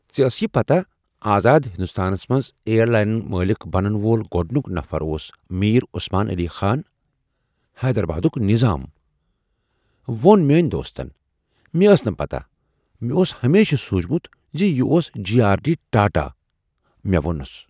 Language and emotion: Kashmiri, surprised